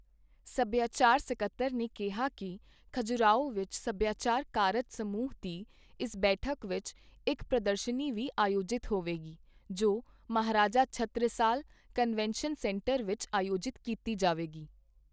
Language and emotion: Punjabi, neutral